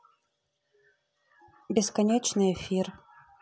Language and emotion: Russian, neutral